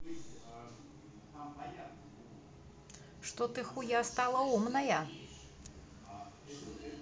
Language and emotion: Russian, neutral